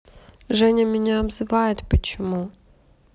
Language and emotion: Russian, sad